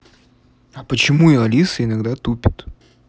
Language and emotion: Russian, neutral